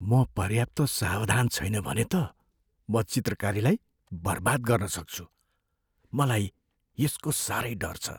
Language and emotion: Nepali, fearful